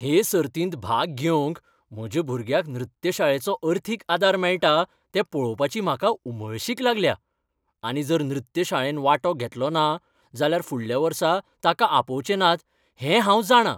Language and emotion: Goan Konkani, happy